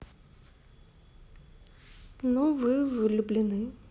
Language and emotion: Russian, sad